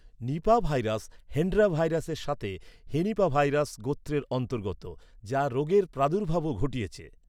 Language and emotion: Bengali, neutral